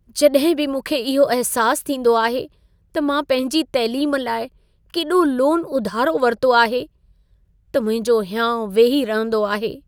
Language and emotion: Sindhi, sad